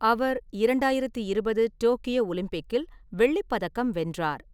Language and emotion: Tamil, neutral